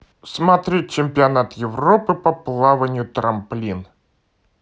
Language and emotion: Russian, positive